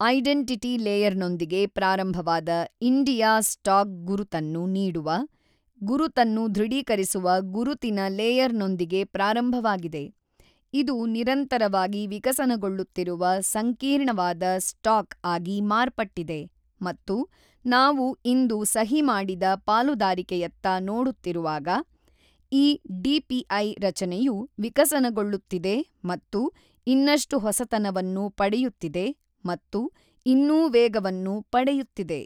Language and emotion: Kannada, neutral